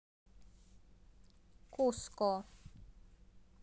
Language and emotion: Russian, neutral